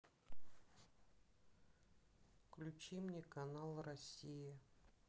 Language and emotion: Russian, sad